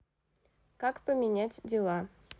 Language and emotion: Russian, neutral